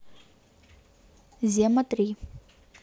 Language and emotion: Russian, neutral